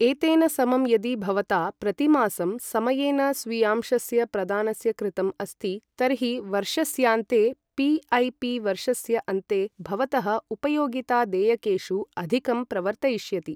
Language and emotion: Sanskrit, neutral